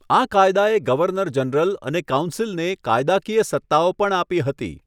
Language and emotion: Gujarati, neutral